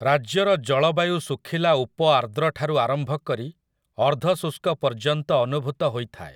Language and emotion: Odia, neutral